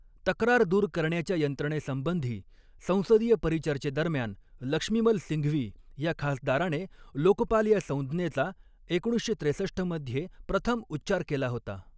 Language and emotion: Marathi, neutral